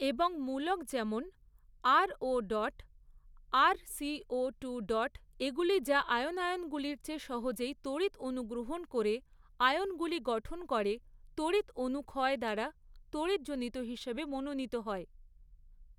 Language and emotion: Bengali, neutral